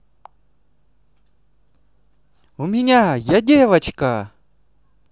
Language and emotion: Russian, positive